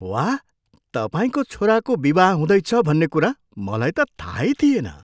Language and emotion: Nepali, surprised